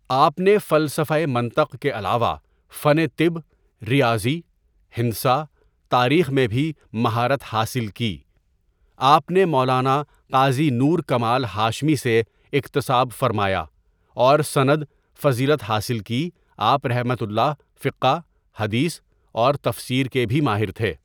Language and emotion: Urdu, neutral